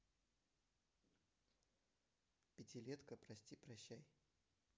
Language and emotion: Russian, neutral